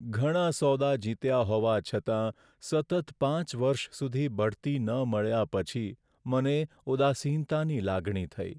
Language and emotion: Gujarati, sad